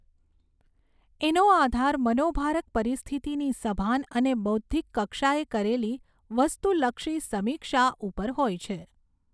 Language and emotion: Gujarati, neutral